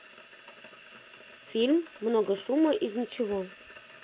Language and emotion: Russian, neutral